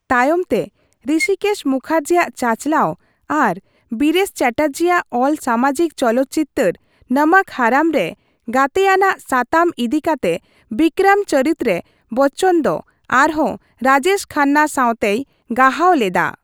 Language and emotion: Santali, neutral